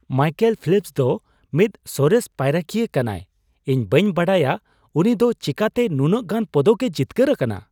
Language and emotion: Santali, surprised